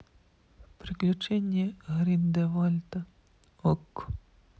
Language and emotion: Russian, sad